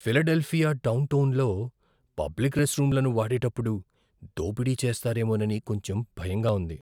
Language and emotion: Telugu, fearful